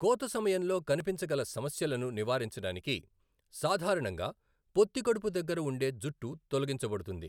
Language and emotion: Telugu, neutral